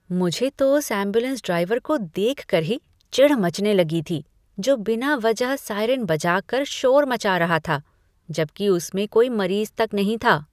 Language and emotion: Hindi, disgusted